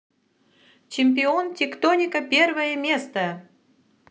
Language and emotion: Russian, positive